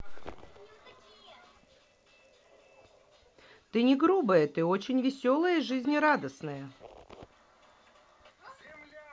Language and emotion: Russian, neutral